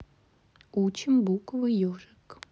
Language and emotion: Russian, neutral